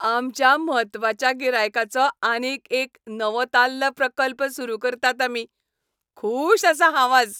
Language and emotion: Goan Konkani, happy